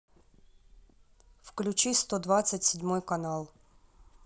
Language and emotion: Russian, neutral